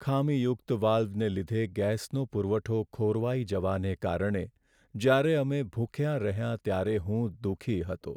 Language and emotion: Gujarati, sad